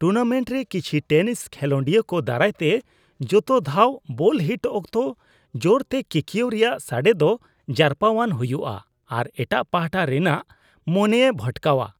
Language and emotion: Santali, disgusted